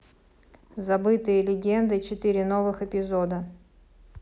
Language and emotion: Russian, neutral